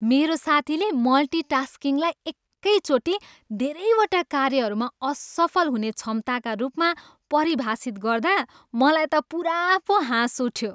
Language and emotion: Nepali, happy